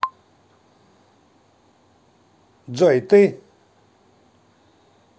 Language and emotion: Russian, neutral